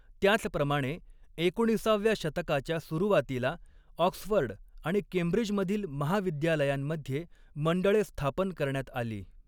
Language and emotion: Marathi, neutral